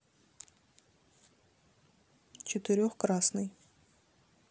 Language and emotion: Russian, neutral